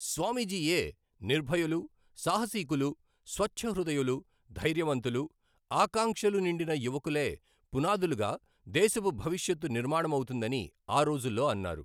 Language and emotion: Telugu, neutral